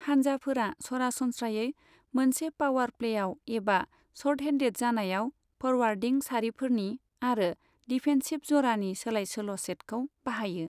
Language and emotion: Bodo, neutral